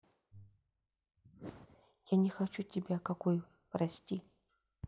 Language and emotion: Russian, sad